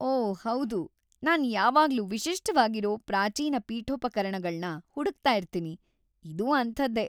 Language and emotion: Kannada, happy